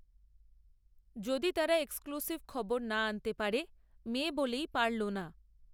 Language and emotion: Bengali, neutral